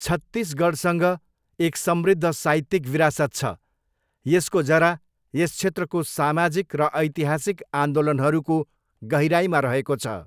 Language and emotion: Nepali, neutral